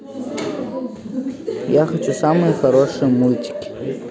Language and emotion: Russian, neutral